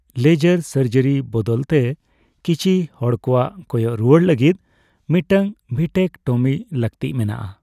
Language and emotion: Santali, neutral